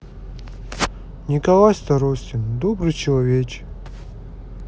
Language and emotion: Russian, sad